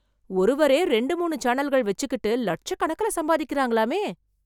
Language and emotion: Tamil, surprised